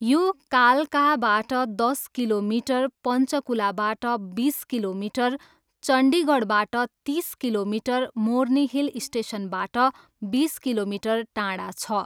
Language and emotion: Nepali, neutral